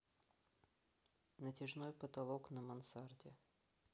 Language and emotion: Russian, neutral